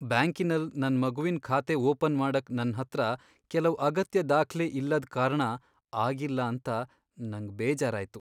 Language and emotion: Kannada, sad